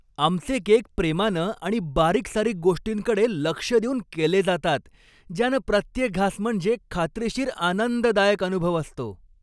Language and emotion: Marathi, happy